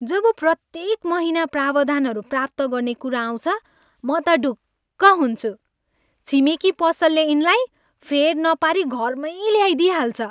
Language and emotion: Nepali, happy